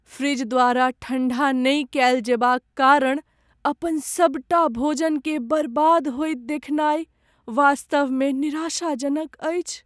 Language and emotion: Maithili, sad